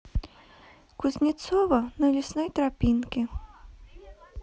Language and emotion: Russian, neutral